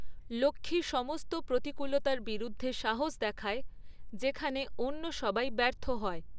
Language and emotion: Bengali, neutral